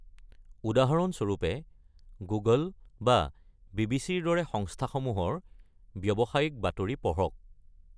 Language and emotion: Assamese, neutral